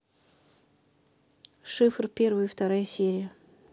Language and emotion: Russian, neutral